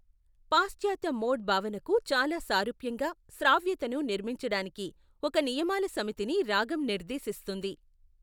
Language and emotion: Telugu, neutral